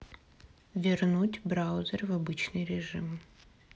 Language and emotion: Russian, neutral